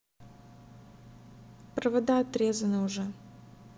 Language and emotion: Russian, neutral